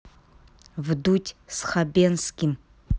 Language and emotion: Russian, neutral